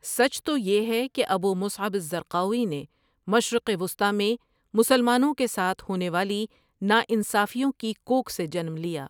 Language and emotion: Urdu, neutral